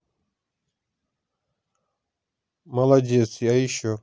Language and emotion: Russian, neutral